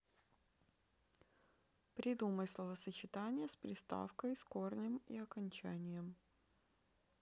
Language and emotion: Russian, neutral